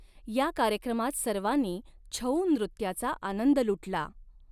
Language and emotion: Marathi, neutral